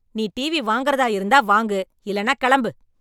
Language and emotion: Tamil, angry